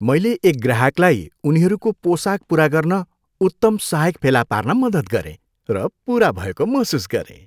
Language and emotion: Nepali, happy